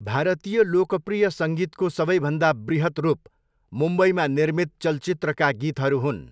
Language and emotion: Nepali, neutral